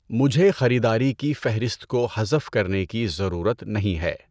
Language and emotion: Urdu, neutral